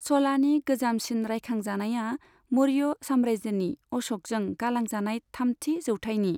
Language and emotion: Bodo, neutral